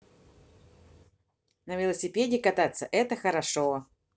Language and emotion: Russian, positive